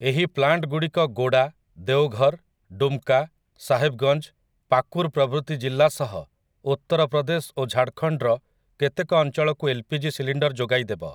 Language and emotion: Odia, neutral